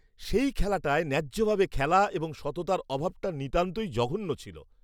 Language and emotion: Bengali, disgusted